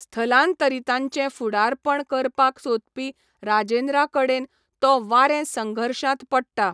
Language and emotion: Goan Konkani, neutral